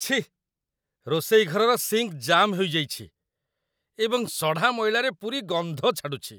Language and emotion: Odia, disgusted